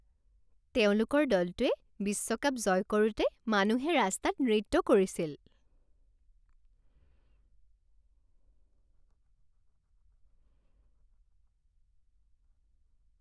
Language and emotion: Assamese, happy